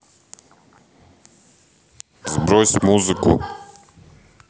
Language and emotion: Russian, neutral